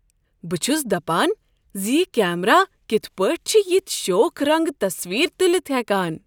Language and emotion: Kashmiri, surprised